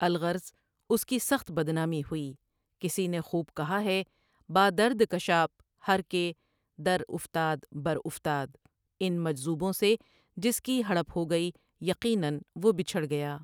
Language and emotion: Urdu, neutral